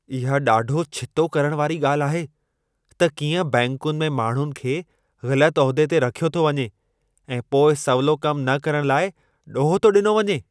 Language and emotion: Sindhi, angry